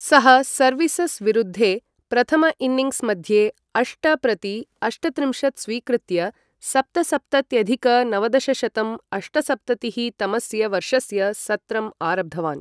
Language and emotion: Sanskrit, neutral